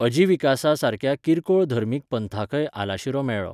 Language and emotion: Goan Konkani, neutral